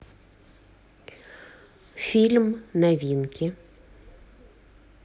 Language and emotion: Russian, neutral